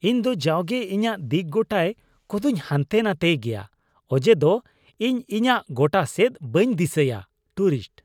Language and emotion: Santali, disgusted